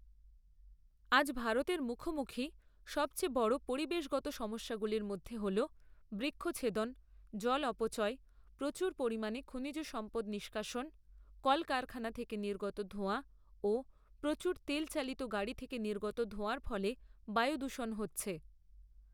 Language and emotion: Bengali, neutral